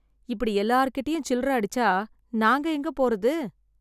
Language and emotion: Tamil, sad